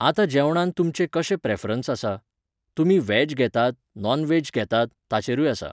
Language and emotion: Goan Konkani, neutral